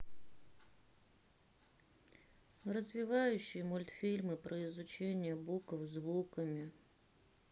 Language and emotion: Russian, sad